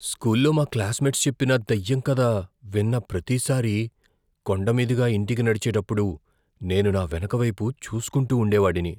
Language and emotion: Telugu, fearful